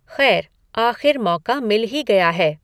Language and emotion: Hindi, neutral